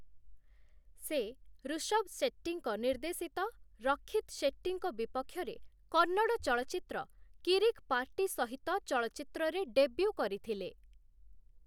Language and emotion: Odia, neutral